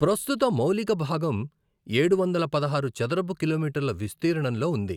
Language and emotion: Telugu, neutral